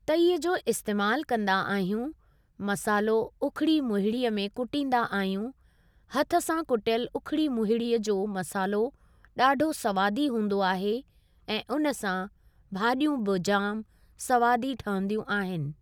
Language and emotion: Sindhi, neutral